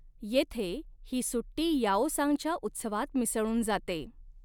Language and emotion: Marathi, neutral